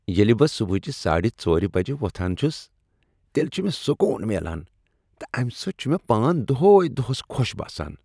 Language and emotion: Kashmiri, happy